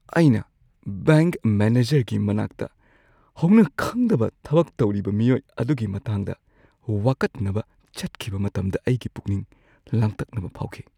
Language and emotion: Manipuri, fearful